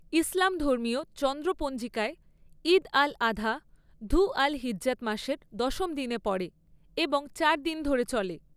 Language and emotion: Bengali, neutral